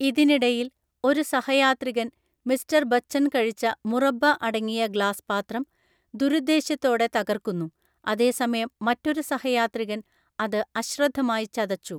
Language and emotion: Malayalam, neutral